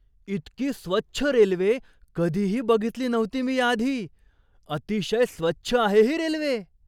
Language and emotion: Marathi, surprised